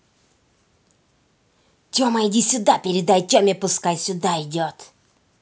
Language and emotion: Russian, angry